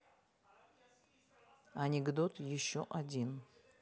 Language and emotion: Russian, neutral